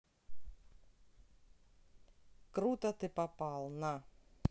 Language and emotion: Russian, neutral